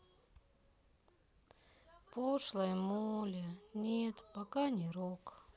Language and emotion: Russian, sad